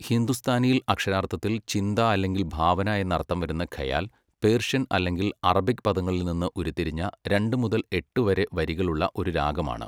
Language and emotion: Malayalam, neutral